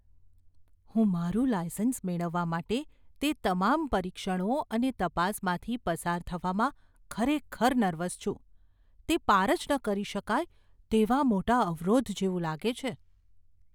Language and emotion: Gujarati, fearful